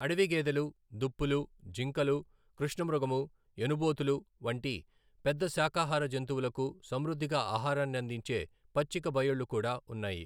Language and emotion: Telugu, neutral